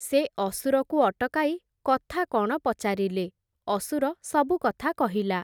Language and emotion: Odia, neutral